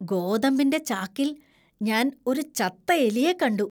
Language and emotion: Malayalam, disgusted